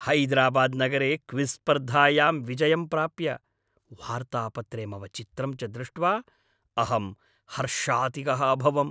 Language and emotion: Sanskrit, happy